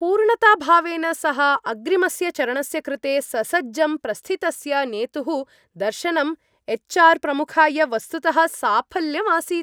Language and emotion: Sanskrit, happy